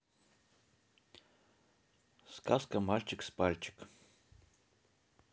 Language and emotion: Russian, neutral